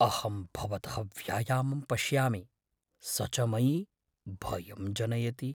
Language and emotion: Sanskrit, fearful